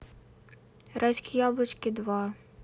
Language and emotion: Russian, neutral